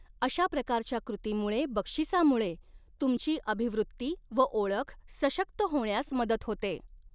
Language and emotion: Marathi, neutral